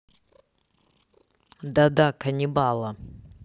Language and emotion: Russian, neutral